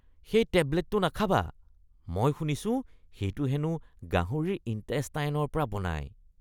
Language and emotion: Assamese, disgusted